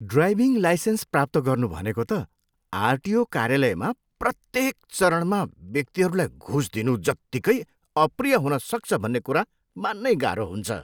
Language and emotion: Nepali, disgusted